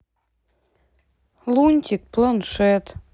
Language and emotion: Russian, sad